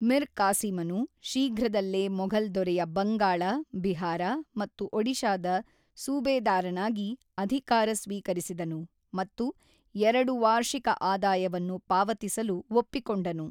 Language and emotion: Kannada, neutral